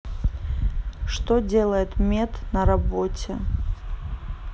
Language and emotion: Russian, neutral